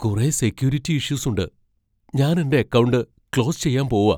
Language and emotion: Malayalam, fearful